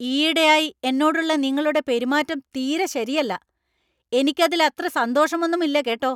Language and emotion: Malayalam, angry